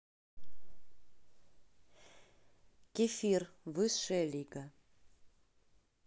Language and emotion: Russian, neutral